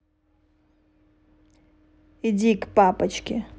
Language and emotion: Russian, angry